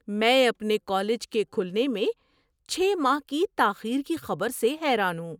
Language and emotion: Urdu, surprised